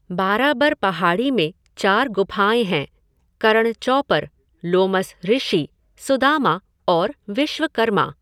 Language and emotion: Hindi, neutral